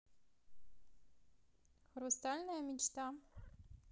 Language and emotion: Russian, neutral